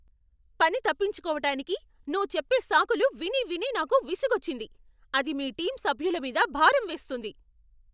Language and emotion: Telugu, angry